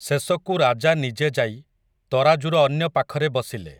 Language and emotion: Odia, neutral